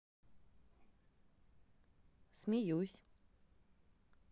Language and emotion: Russian, neutral